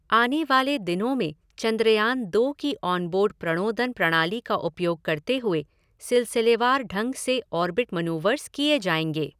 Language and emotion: Hindi, neutral